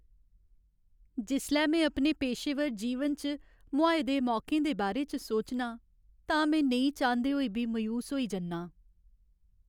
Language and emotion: Dogri, sad